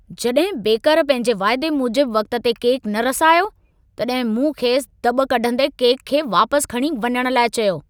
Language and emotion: Sindhi, angry